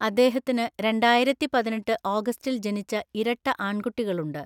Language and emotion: Malayalam, neutral